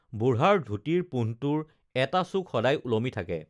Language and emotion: Assamese, neutral